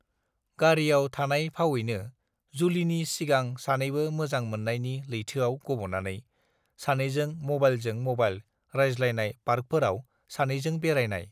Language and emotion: Bodo, neutral